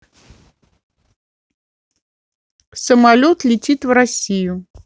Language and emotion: Russian, neutral